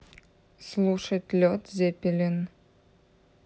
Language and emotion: Russian, neutral